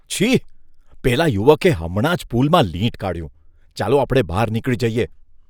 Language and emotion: Gujarati, disgusted